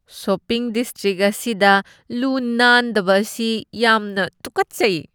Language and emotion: Manipuri, disgusted